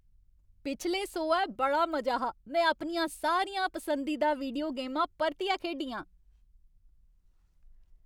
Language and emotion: Dogri, happy